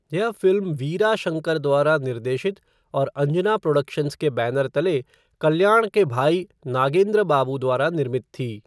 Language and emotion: Hindi, neutral